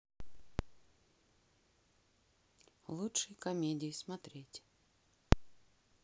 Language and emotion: Russian, neutral